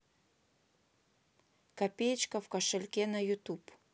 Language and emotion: Russian, neutral